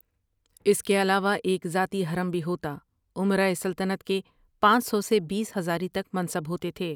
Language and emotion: Urdu, neutral